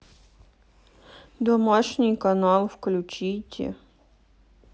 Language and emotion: Russian, sad